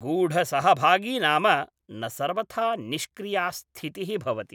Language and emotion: Sanskrit, neutral